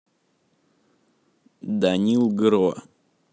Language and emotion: Russian, neutral